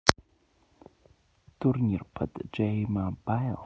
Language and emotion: Russian, neutral